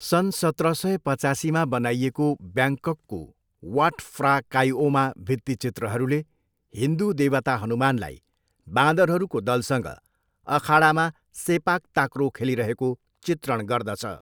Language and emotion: Nepali, neutral